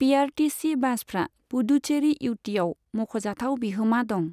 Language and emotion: Bodo, neutral